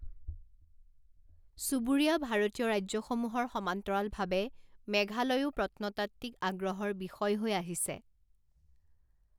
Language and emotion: Assamese, neutral